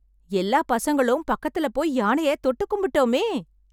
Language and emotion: Tamil, happy